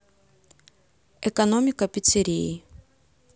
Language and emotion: Russian, neutral